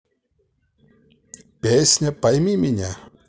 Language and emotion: Russian, positive